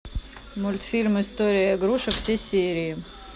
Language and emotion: Russian, neutral